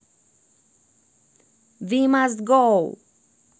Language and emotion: Russian, positive